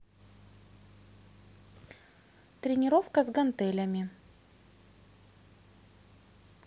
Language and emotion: Russian, neutral